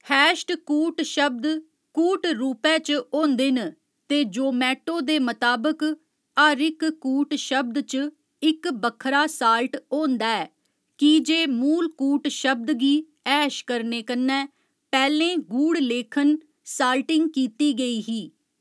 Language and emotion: Dogri, neutral